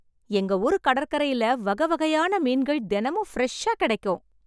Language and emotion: Tamil, happy